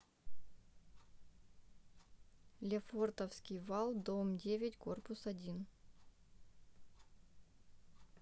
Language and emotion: Russian, neutral